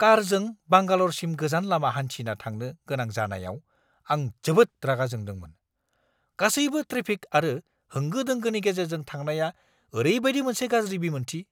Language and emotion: Bodo, angry